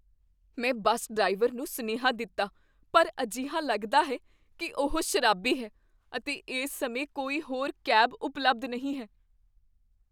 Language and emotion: Punjabi, fearful